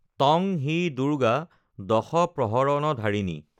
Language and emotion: Assamese, neutral